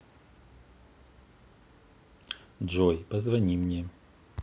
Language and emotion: Russian, neutral